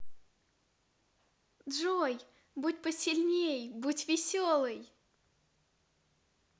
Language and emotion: Russian, positive